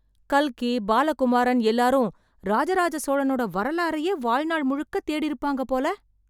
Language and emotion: Tamil, surprised